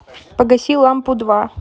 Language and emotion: Russian, neutral